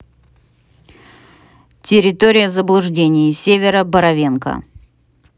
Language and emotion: Russian, neutral